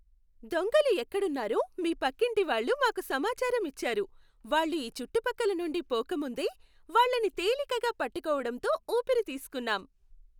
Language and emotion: Telugu, happy